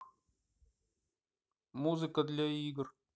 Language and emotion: Russian, neutral